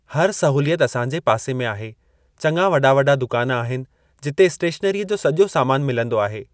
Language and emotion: Sindhi, neutral